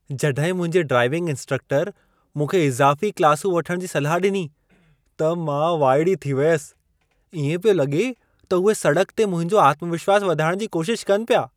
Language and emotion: Sindhi, surprised